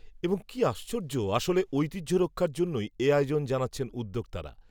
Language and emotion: Bengali, neutral